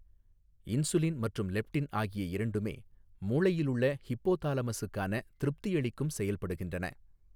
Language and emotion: Tamil, neutral